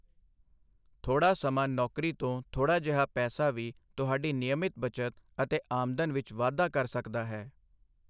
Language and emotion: Punjabi, neutral